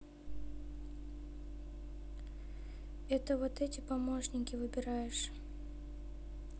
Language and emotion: Russian, sad